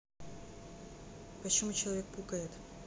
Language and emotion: Russian, neutral